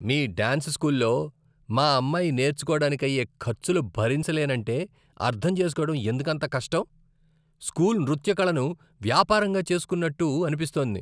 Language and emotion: Telugu, disgusted